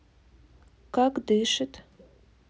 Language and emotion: Russian, neutral